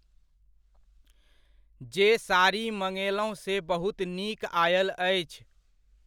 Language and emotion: Maithili, neutral